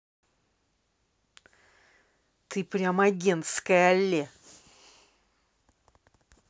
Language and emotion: Russian, angry